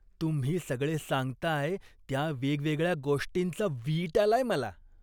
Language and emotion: Marathi, disgusted